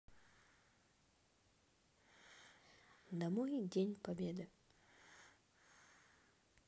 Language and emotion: Russian, neutral